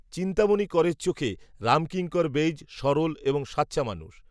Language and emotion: Bengali, neutral